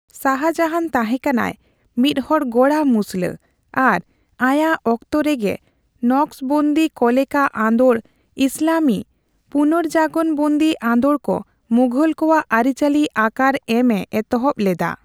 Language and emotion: Santali, neutral